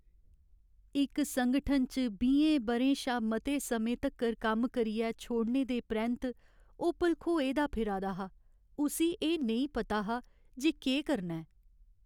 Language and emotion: Dogri, sad